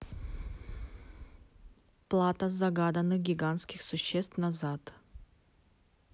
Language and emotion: Russian, neutral